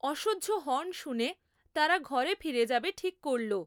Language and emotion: Bengali, neutral